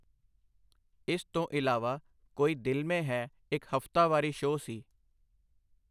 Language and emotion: Punjabi, neutral